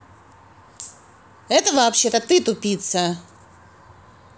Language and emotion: Russian, angry